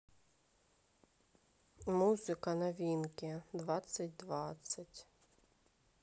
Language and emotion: Russian, neutral